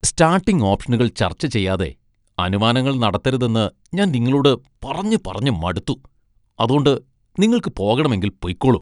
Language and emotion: Malayalam, disgusted